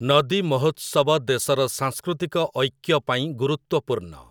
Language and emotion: Odia, neutral